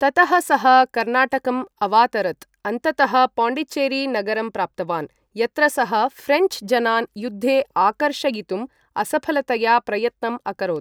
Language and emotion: Sanskrit, neutral